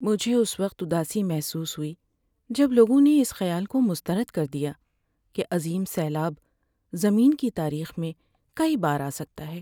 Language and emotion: Urdu, sad